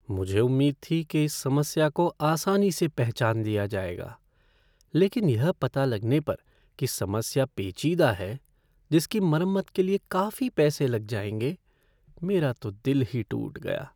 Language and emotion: Hindi, sad